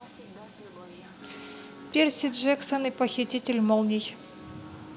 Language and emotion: Russian, neutral